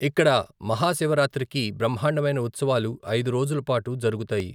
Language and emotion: Telugu, neutral